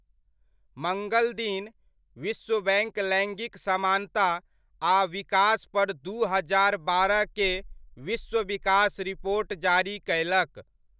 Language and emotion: Maithili, neutral